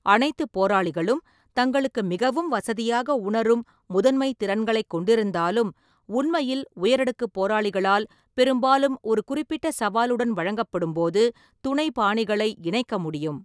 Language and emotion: Tamil, neutral